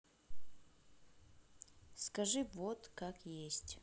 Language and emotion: Russian, neutral